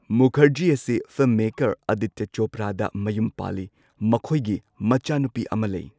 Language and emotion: Manipuri, neutral